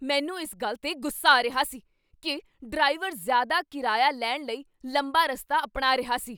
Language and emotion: Punjabi, angry